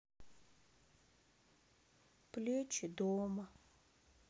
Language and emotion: Russian, sad